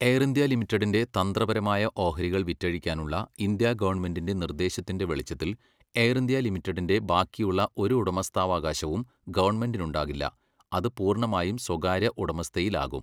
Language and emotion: Malayalam, neutral